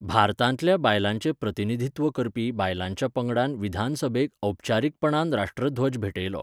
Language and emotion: Goan Konkani, neutral